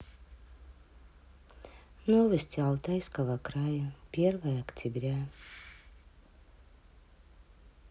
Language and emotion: Russian, neutral